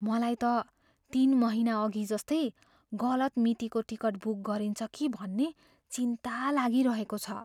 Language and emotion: Nepali, fearful